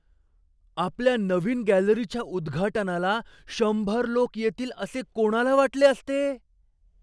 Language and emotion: Marathi, surprised